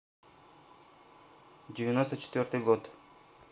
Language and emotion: Russian, neutral